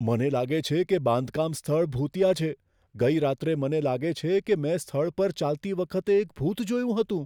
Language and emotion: Gujarati, fearful